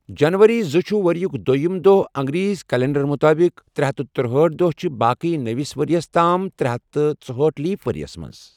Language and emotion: Kashmiri, neutral